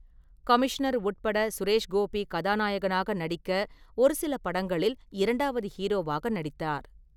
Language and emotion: Tamil, neutral